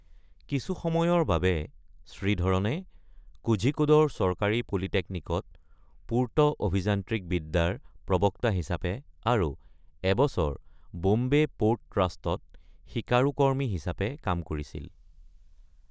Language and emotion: Assamese, neutral